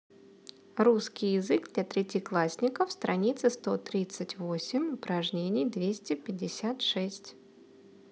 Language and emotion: Russian, neutral